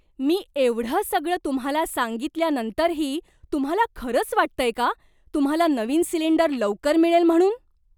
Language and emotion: Marathi, surprised